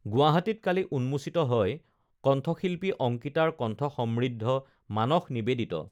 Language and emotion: Assamese, neutral